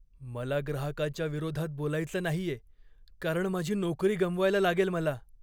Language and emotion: Marathi, fearful